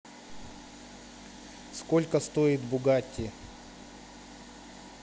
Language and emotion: Russian, neutral